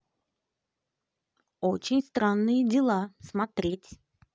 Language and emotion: Russian, positive